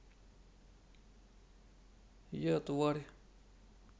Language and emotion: Russian, neutral